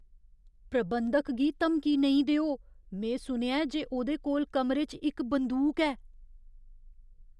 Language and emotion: Dogri, fearful